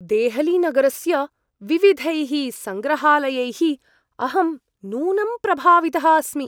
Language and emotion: Sanskrit, surprised